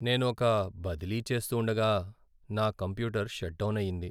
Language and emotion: Telugu, sad